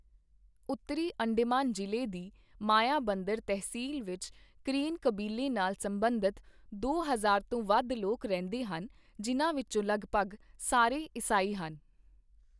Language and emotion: Punjabi, neutral